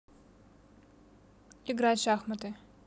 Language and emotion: Russian, neutral